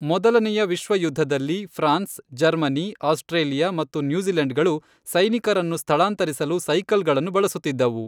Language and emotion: Kannada, neutral